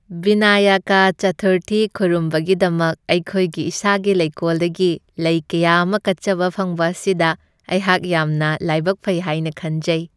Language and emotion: Manipuri, happy